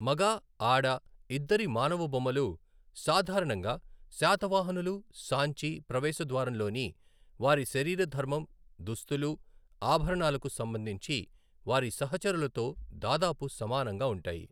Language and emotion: Telugu, neutral